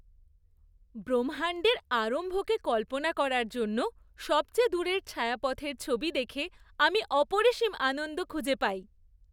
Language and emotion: Bengali, happy